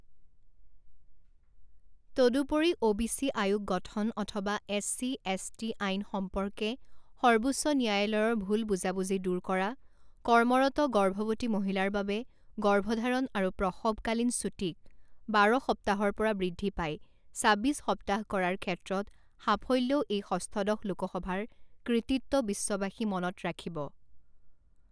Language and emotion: Assamese, neutral